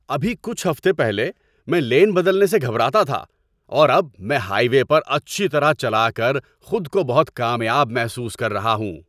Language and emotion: Urdu, happy